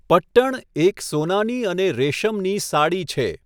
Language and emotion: Gujarati, neutral